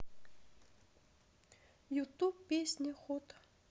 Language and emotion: Russian, sad